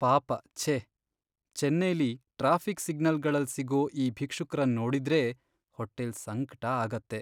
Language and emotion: Kannada, sad